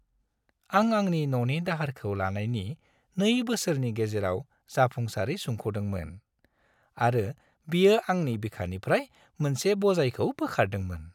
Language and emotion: Bodo, happy